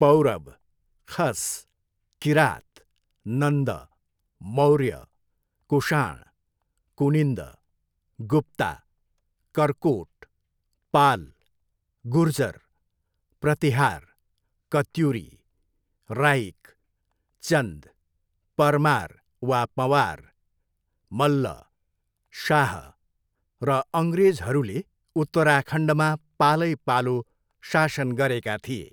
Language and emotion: Nepali, neutral